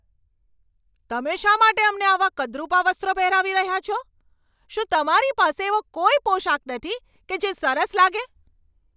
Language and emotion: Gujarati, angry